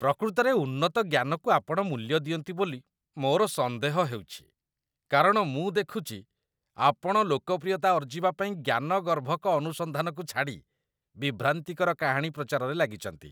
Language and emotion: Odia, disgusted